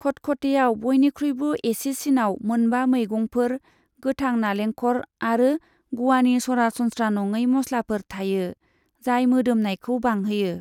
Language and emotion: Bodo, neutral